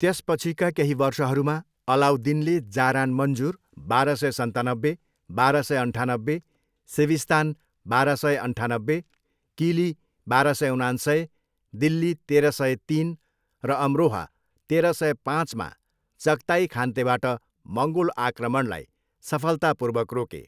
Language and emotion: Nepali, neutral